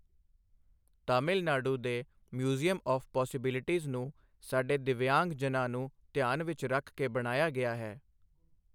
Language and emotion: Punjabi, neutral